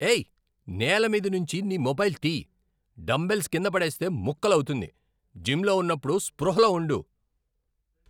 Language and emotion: Telugu, angry